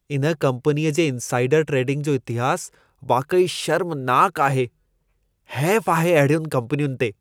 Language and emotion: Sindhi, disgusted